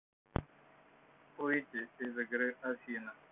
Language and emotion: Russian, neutral